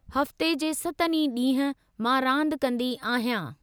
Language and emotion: Sindhi, neutral